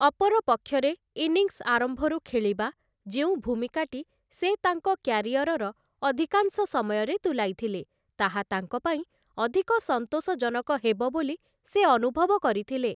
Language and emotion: Odia, neutral